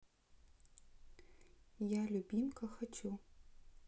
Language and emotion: Russian, neutral